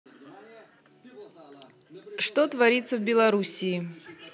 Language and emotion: Russian, neutral